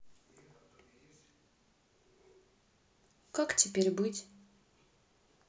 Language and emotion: Russian, sad